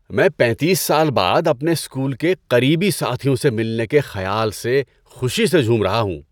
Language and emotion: Urdu, happy